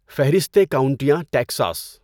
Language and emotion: Urdu, neutral